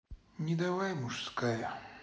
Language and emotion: Russian, sad